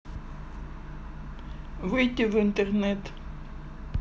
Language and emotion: Russian, neutral